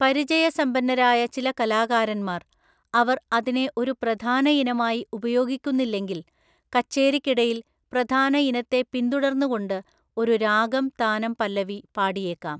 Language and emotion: Malayalam, neutral